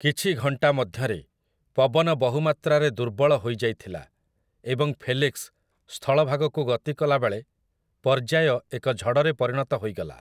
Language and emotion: Odia, neutral